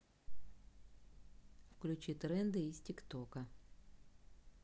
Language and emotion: Russian, neutral